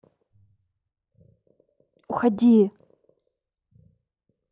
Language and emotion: Russian, neutral